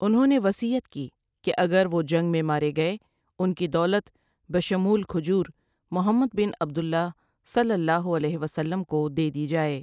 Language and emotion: Urdu, neutral